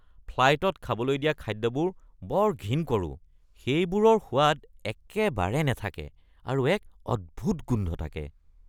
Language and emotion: Assamese, disgusted